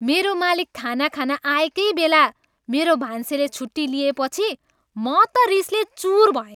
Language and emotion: Nepali, angry